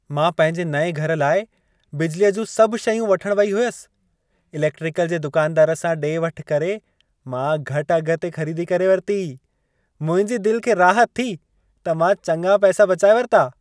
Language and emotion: Sindhi, happy